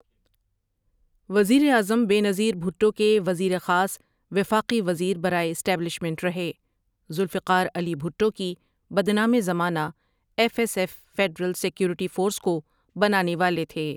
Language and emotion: Urdu, neutral